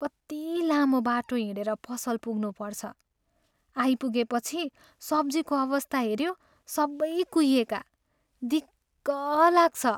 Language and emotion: Nepali, sad